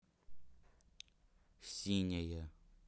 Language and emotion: Russian, neutral